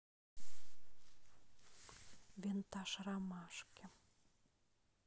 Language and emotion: Russian, neutral